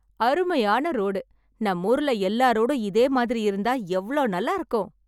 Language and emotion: Tamil, happy